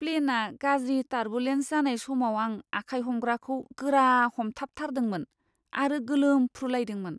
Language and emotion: Bodo, fearful